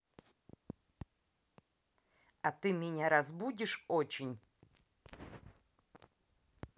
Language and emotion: Russian, neutral